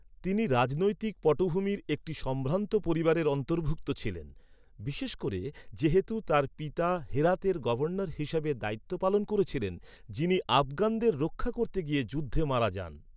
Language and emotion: Bengali, neutral